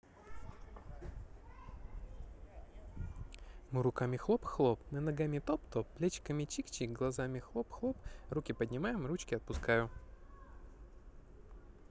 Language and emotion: Russian, positive